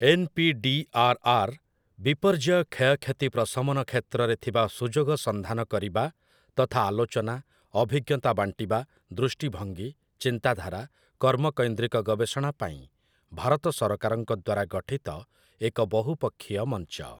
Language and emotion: Odia, neutral